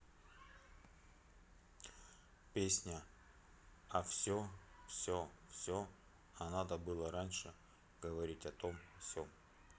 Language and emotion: Russian, neutral